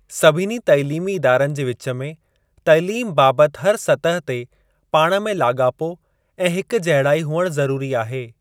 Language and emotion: Sindhi, neutral